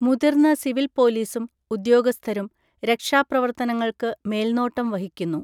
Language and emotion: Malayalam, neutral